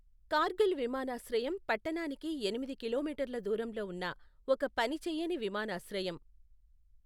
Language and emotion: Telugu, neutral